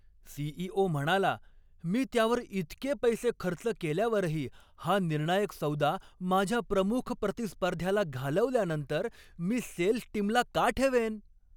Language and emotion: Marathi, angry